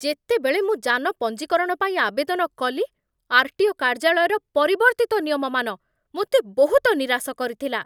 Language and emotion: Odia, angry